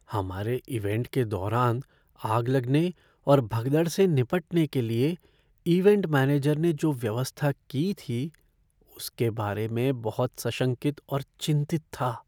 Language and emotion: Hindi, fearful